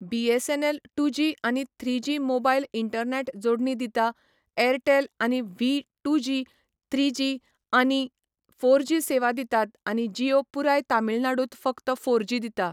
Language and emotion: Goan Konkani, neutral